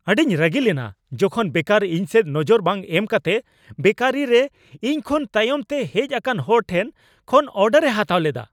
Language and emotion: Santali, angry